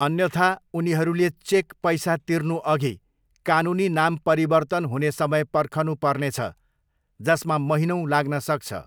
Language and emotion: Nepali, neutral